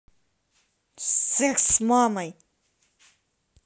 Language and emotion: Russian, angry